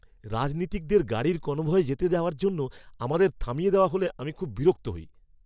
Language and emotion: Bengali, angry